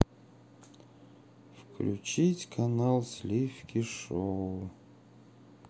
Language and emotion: Russian, sad